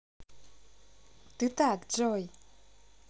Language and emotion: Russian, positive